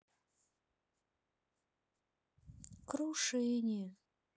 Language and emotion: Russian, sad